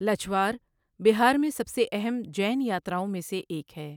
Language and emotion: Urdu, neutral